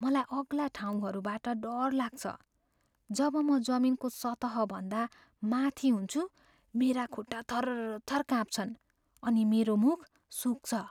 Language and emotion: Nepali, fearful